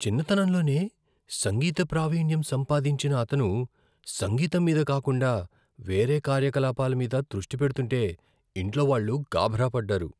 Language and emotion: Telugu, fearful